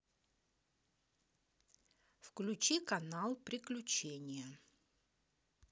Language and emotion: Russian, neutral